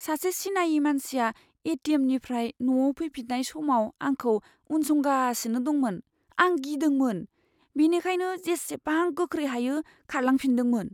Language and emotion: Bodo, fearful